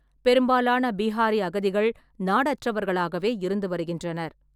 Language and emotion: Tamil, neutral